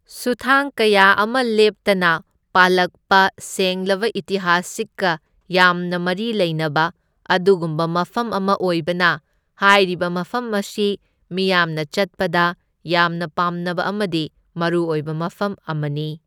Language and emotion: Manipuri, neutral